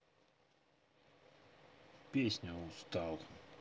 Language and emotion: Russian, neutral